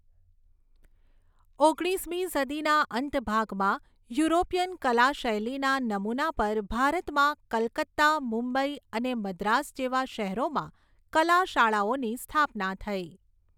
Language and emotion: Gujarati, neutral